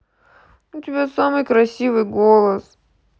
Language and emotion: Russian, sad